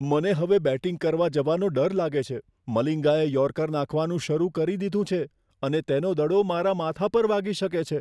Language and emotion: Gujarati, fearful